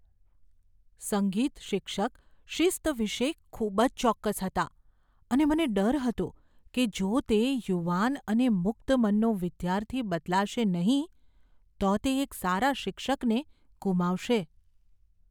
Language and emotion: Gujarati, fearful